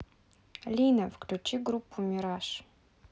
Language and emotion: Russian, neutral